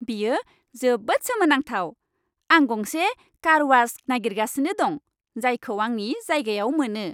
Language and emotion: Bodo, happy